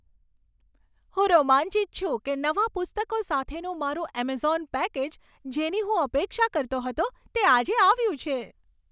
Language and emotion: Gujarati, happy